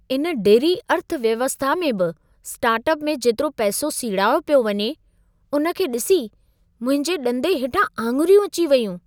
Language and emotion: Sindhi, surprised